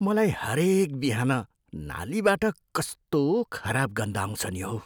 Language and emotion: Nepali, disgusted